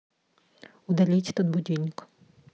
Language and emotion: Russian, neutral